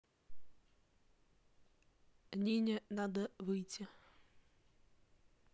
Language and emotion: Russian, neutral